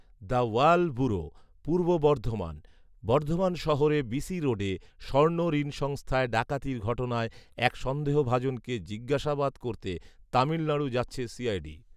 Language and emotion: Bengali, neutral